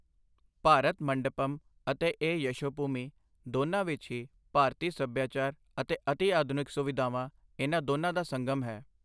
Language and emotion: Punjabi, neutral